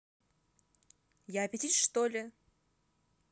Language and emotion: Russian, angry